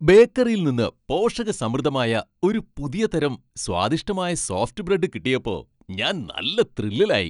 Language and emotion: Malayalam, happy